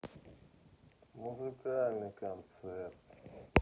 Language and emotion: Russian, neutral